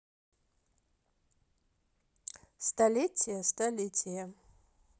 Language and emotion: Russian, neutral